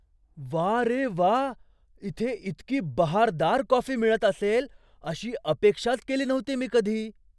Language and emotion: Marathi, surprised